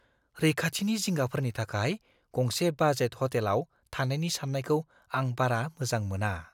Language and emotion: Bodo, fearful